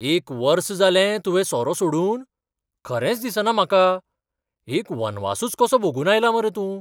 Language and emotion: Goan Konkani, surprised